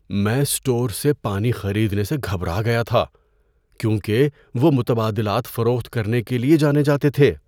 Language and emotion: Urdu, fearful